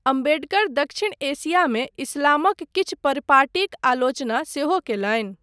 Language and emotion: Maithili, neutral